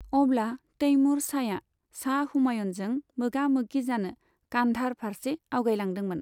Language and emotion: Bodo, neutral